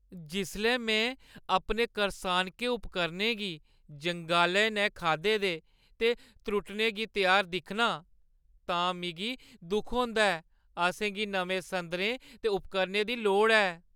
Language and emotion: Dogri, sad